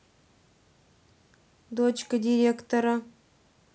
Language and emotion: Russian, neutral